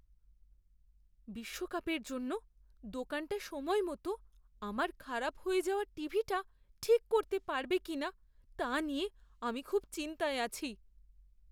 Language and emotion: Bengali, fearful